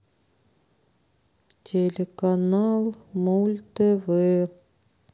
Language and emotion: Russian, sad